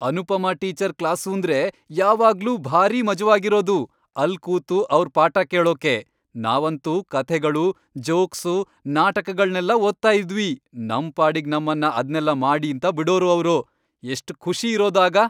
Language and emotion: Kannada, happy